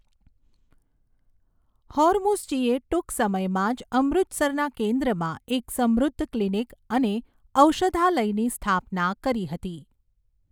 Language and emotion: Gujarati, neutral